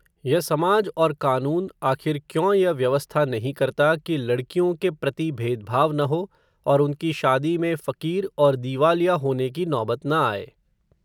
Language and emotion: Hindi, neutral